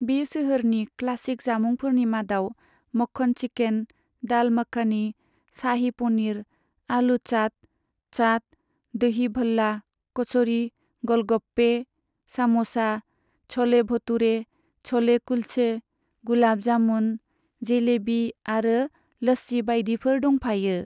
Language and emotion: Bodo, neutral